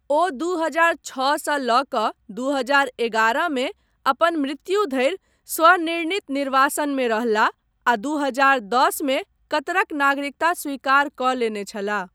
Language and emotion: Maithili, neutral